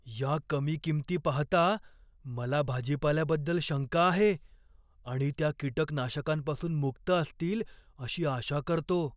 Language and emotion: Marathi, fearful